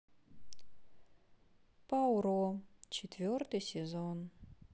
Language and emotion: Russian, sad